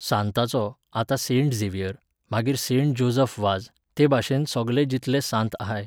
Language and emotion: Goan Konkani, neutral